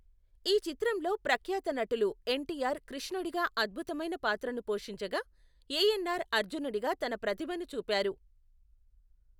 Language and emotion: Telugu, neutral